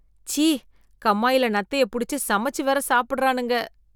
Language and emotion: Tamil, disgusted